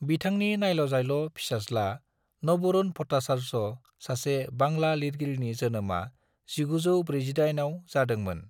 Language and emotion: Bodo, neutral